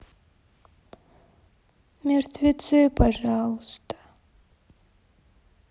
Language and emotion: Russian, sad